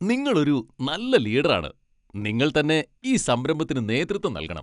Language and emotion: Malayalam, happy